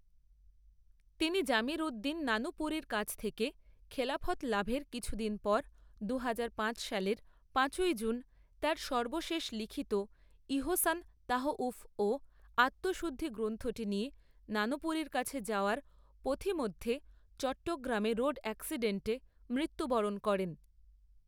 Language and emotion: Bengali, neutral